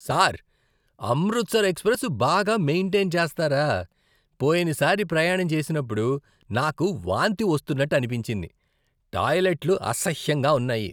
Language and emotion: Telugu, disgusted